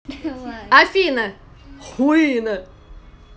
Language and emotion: Russian, angry